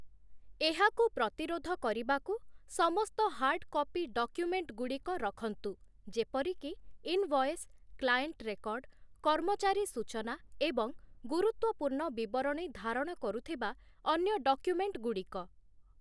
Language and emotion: Odia, neutral